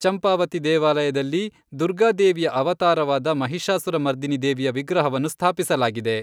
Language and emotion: Kannada, neutral